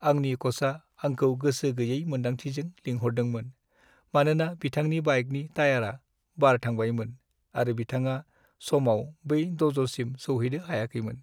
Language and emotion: Bodo, sad